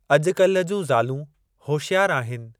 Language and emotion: Sindhi, neutral